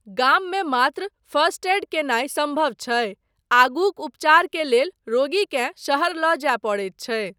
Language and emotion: Maithili, neutral